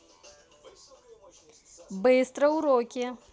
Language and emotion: Russian, positive